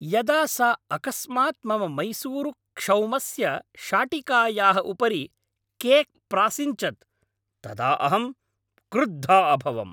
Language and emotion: Sanskrit, angry